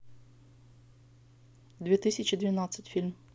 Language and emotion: Russian, neutral